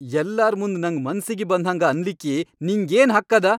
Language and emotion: Kannada, angry